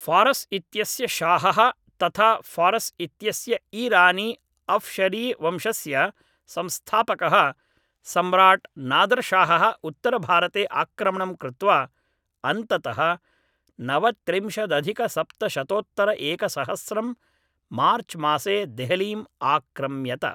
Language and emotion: Sanskrit, neutral